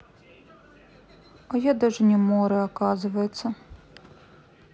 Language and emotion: Russian, sad